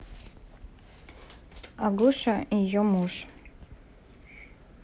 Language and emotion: Russian, neutral